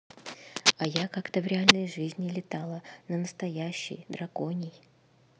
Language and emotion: Russian, neutral